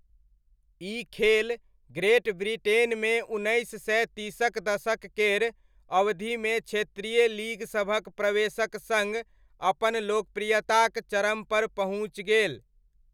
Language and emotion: Maithili, neutral